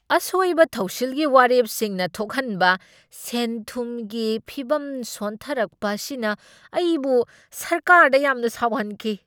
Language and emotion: Manipuri, angry